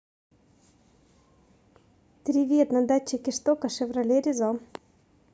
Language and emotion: Russian, positive